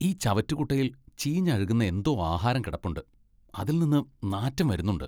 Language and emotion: Malayalam, disgusted